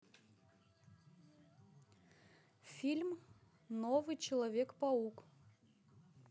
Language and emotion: Russian, neutral